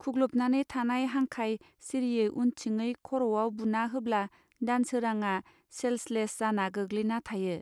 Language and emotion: Bodo, neutral